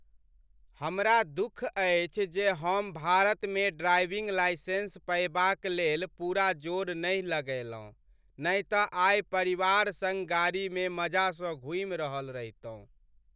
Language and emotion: Maithili, sad